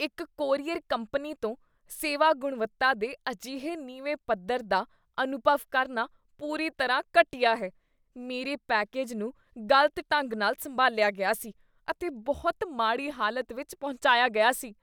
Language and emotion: Punjabi, disgusted